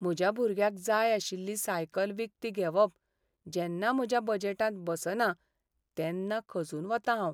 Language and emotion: Goan Konkani, sad